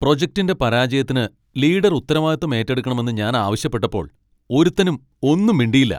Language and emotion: Malayalam, angry